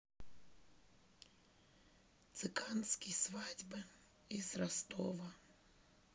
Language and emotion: Russian, sad